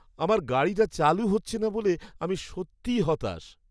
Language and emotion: Bengali, sad